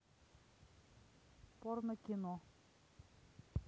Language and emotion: Russian, neutral